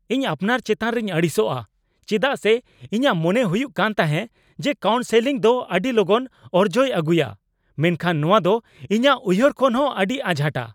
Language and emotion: Santali, angry